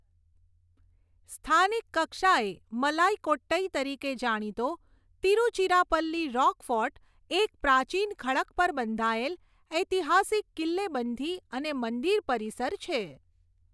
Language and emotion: Gujarati, neutral